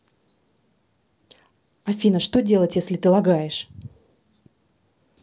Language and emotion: Russian, angry